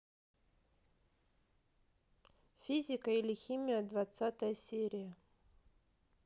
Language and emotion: Russian, neutral